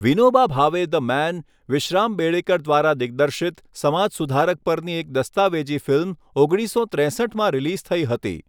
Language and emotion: Gujarati, neutral